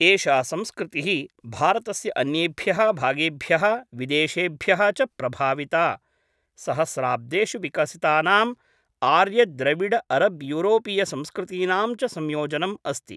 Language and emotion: Sanskrit, neutral